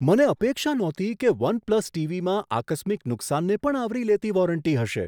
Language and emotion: Gujarati, surprised